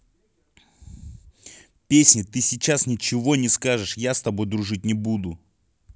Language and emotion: Russian, angry